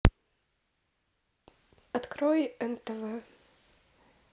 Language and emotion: Russian, neutral